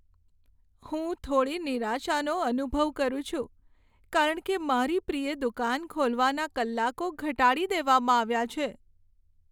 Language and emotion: Gujarati, sad